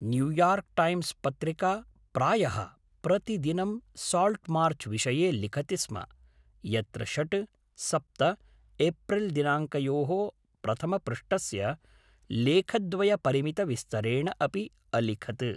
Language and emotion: Sanskrit, neutral